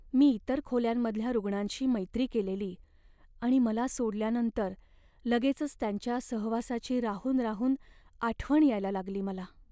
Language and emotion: Marathi, sad